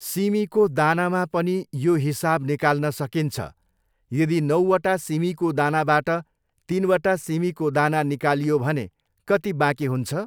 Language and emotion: Nepali, neutral